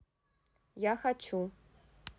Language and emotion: Russian, neutral